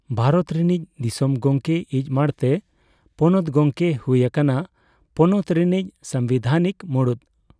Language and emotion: Santali, neutral